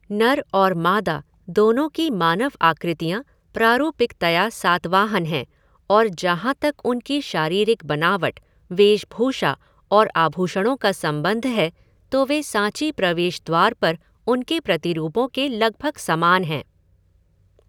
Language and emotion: Hindi, neutral